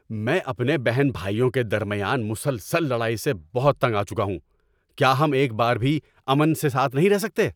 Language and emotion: Urdu, angry